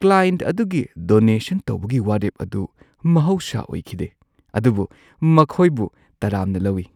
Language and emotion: Manipuri, surprised